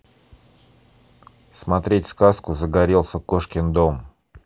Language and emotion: Russian, neutral